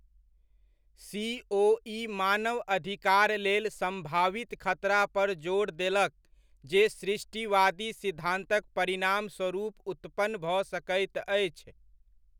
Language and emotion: Maithili, neutral